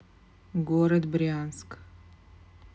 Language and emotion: Russian, neutral